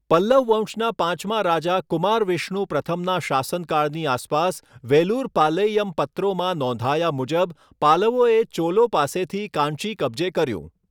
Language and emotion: Gujarati, neutral